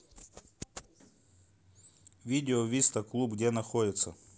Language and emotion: Russian, neutral